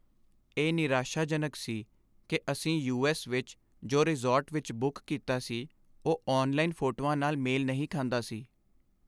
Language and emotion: Punjabi, sad